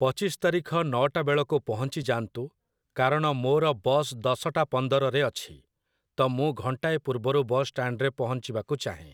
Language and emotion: Odia, neutral